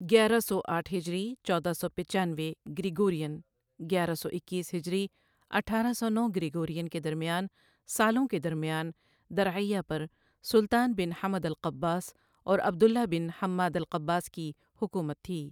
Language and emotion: Urdu, neutral